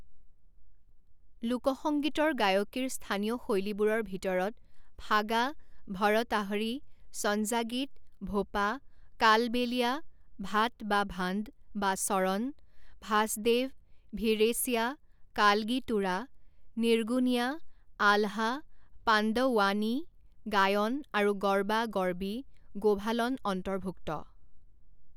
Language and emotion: Assamese, neutral